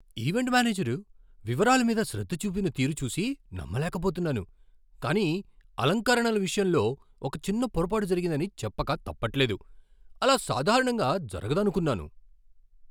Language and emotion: Telugu, surprised